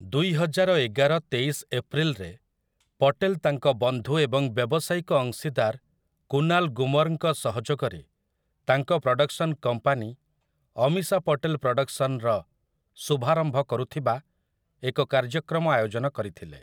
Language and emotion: Odia, neutral